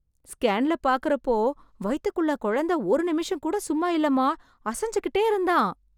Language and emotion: Tamil, surprised